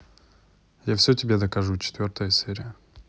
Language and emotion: Russian, neutral